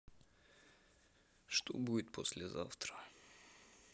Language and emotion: Russian, sad